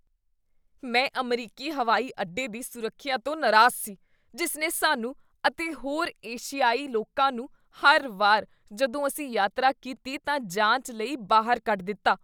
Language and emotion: Punjabi, disgusted